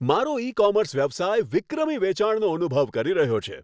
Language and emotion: Gujarati, happy